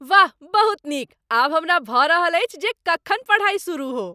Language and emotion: Maithili, happy